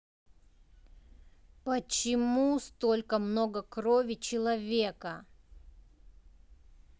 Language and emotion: Russian, angry